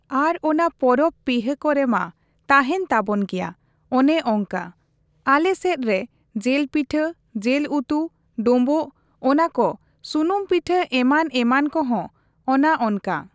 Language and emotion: Santali, neutral